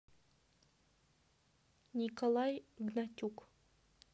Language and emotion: Russian, neutral